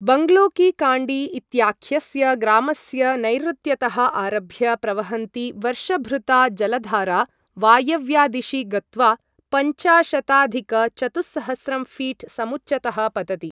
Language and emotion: Sanskrit, neutral